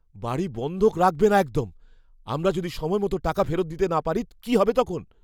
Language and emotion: Bengali, fearful